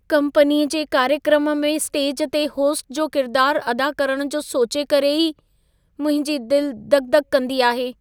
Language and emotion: Sindhi, fearful